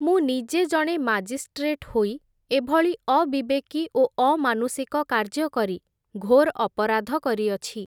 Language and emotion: Odia, neutral